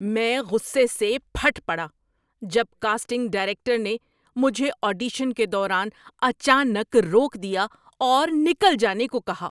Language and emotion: Urdu, angry